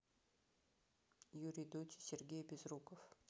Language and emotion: Russian, neutral